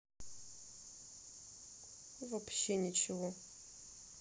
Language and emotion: Russian, sad